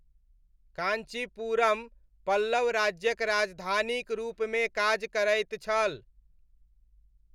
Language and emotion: Maithili, neutral